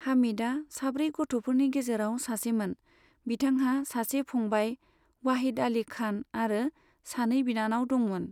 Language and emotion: Bodo, neutral